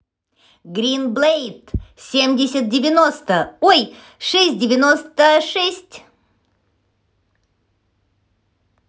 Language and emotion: Russian, positive